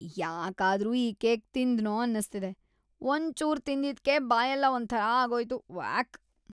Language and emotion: Kannada, disgusted